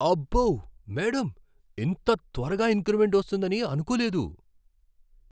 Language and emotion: Telugu, surprised